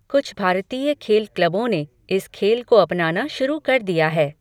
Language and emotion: Hindi, neutral